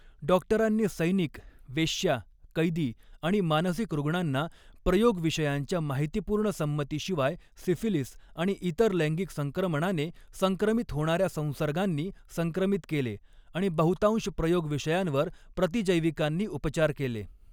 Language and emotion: Marathi, neutral